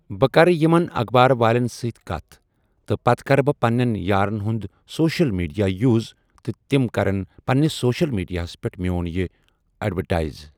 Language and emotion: Kashmiri, neutral